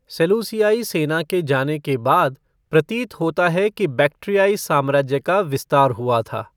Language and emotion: Hindi, neutral